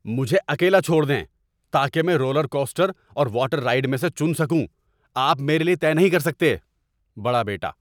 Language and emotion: Urdu, angry